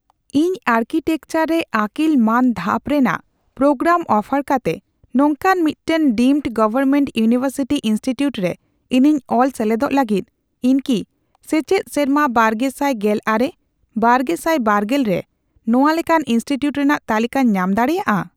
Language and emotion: Santali, neutral